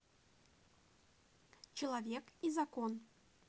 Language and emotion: Russian, neutral